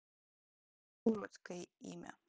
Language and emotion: Russian, neutral